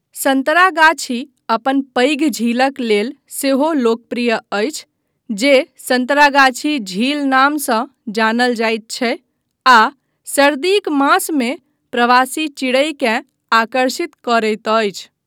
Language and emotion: Maithili, neutral